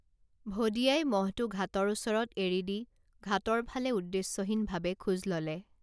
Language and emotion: Assamese, neutral